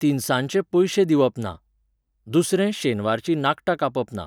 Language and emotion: Goan Konkani, neutral